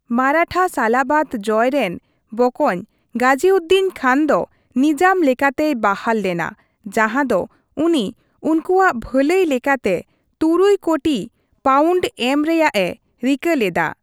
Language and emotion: Santali, neutral